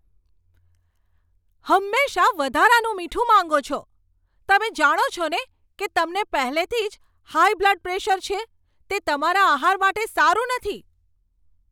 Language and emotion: Gujarati, angry